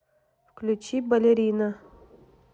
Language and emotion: Russian, neutral